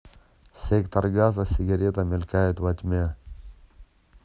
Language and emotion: Russian, neutral